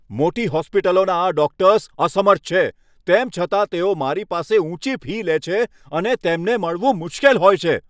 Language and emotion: Gujarati, angry